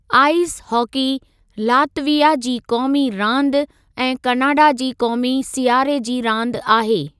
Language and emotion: Sindhi, neutral